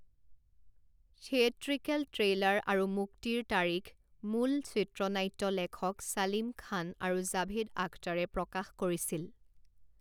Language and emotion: Assamese, neutral